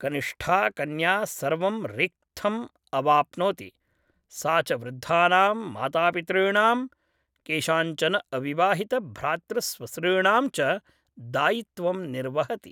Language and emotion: Sanskrit, neutral